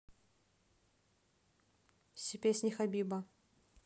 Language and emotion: Russian, neutral